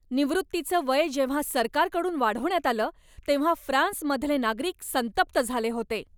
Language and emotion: Marathi, angry